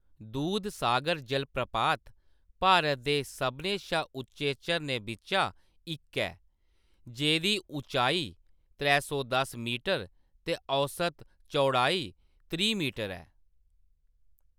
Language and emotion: Dogri, neutral